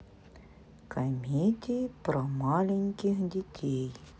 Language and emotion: Russian, neutral